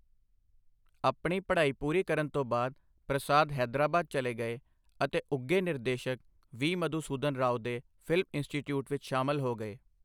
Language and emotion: Punjabi, neutral